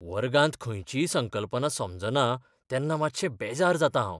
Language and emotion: Goan Konkani, fearful